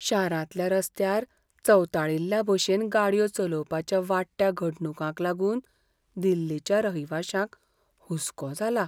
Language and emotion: Goan Konkani, fearful